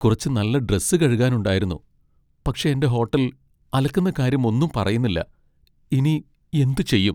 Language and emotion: Malayalam, sad